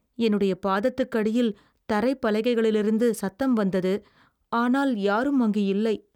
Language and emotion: Tamil, fearful